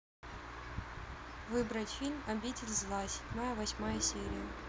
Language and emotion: Russian, neutral